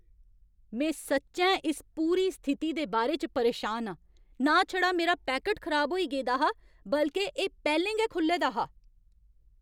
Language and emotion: Dogri, angry